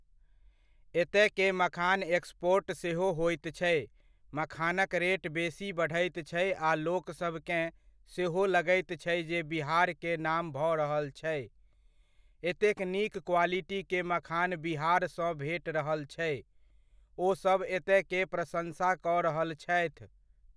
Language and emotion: Maithili, neutral